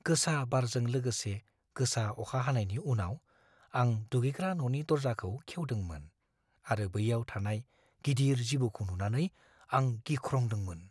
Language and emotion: Bodo, fearful